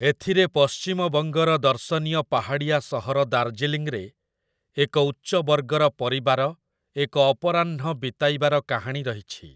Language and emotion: Odia, neutral